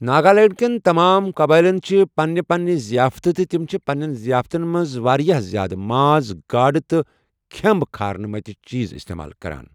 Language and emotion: Kashmiri, neutral